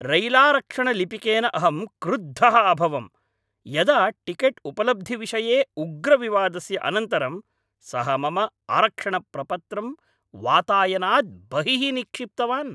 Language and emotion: Sanskrit, angry